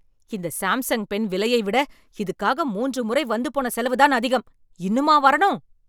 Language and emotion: Tamil, angry